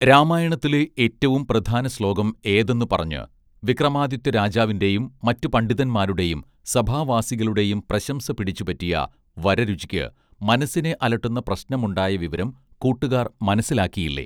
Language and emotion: Malayalam, neutral